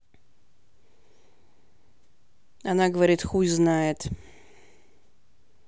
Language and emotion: Russian, angry